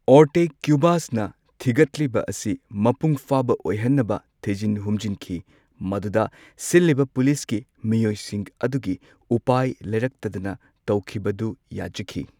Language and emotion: Manipuri, neutral